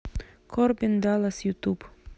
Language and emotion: Russian, neutral